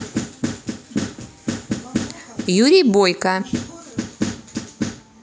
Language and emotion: Russian, positive